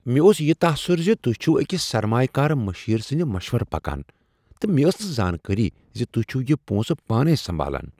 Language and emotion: Kashmiri, surprised